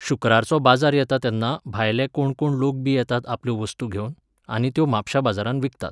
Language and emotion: Goan Konkani, neutral